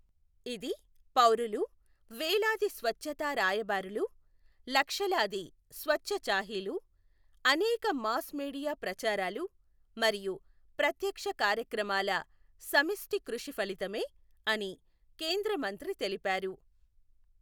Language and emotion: Telugu, neutral